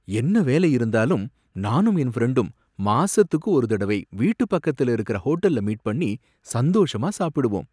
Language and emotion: Tamil, happy